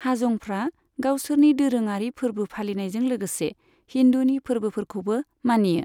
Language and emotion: Bodo, neutral